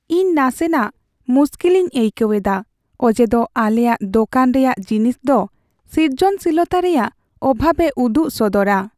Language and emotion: Santali, sad